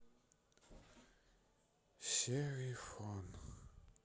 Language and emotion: Russian, sad